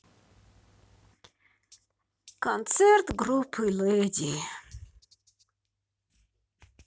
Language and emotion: Russian, sad